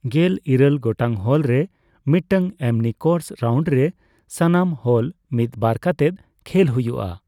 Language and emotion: Santali, neutral